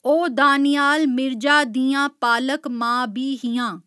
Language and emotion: Dogri, neutral